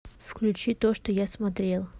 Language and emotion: Russian, neutral